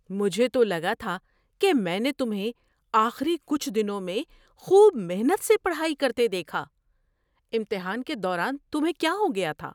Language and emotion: Urdu, surprised